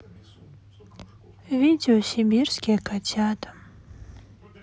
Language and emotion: Russian, sad